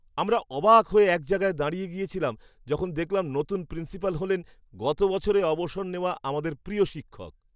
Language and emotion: Bengali, surprised